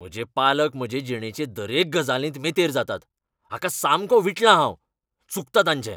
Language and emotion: Goan Konkani, angry